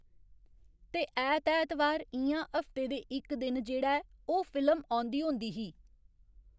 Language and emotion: Dogri, neutral